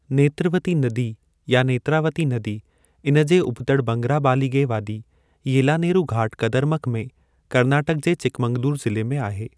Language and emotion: Sindhi, neutral